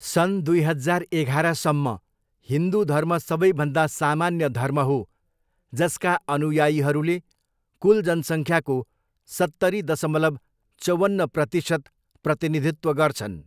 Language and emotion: Nepali, neutral